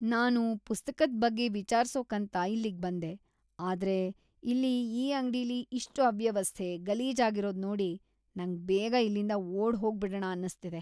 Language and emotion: Kannada, disgusted